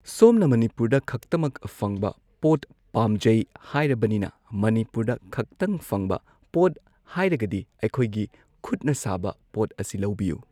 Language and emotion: Manipuri, neutral